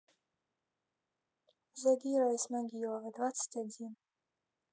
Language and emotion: Russian, neutral